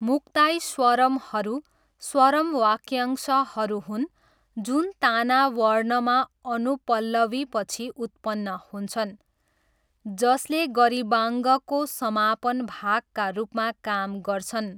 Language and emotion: Nepali, neutral